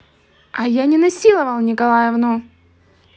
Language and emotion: Russian, angry